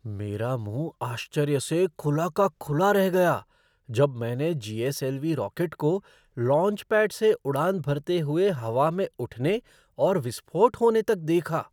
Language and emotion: Hindi, surprised